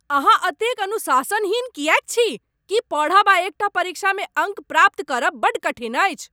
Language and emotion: Maithili, angry